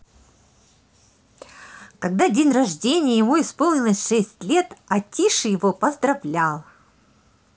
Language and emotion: Russian, positive